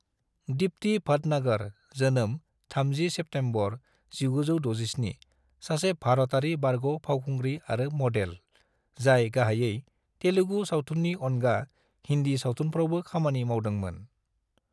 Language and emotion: Bodo, neutral